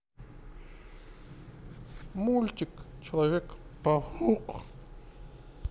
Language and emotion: Russian, neutral